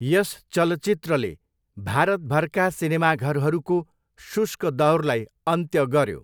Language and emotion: Nepali, neutral